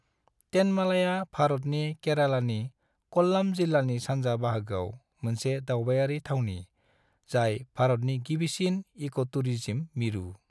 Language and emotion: Bodo, neutral